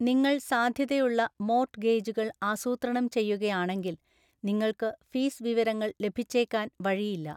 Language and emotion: Malayalam, neutral